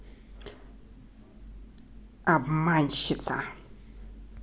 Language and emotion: Russian, angry